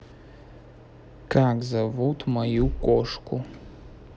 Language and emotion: Russian, neutral